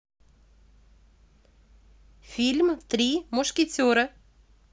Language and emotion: Russian, positive